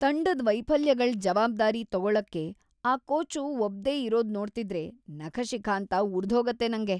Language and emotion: Kannada, disgusted